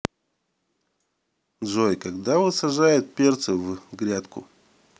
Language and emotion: Russian, neutral